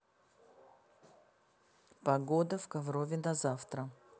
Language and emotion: Russian, neutral